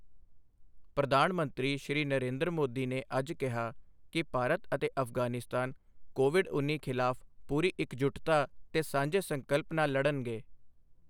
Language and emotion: Punjabi, neutral